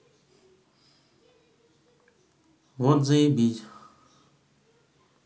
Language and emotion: Russian, neutral